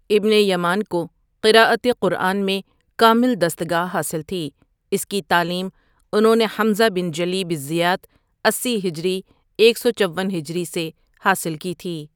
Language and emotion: Urdu, neutral